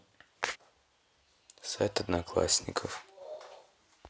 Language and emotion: Russian, neutral